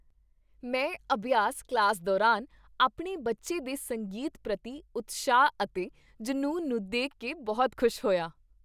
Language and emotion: Punjabi, happy